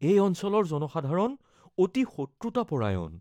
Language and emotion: Assamese, fearful